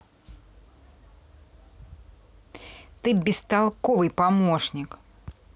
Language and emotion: Russian, angry